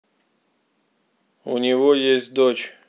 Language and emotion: Russian, neutral